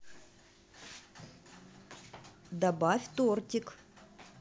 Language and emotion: Russian, positive